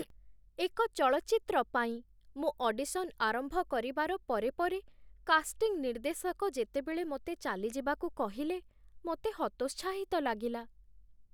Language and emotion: Odia, sad